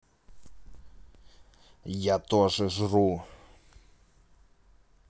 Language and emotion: Russian, angry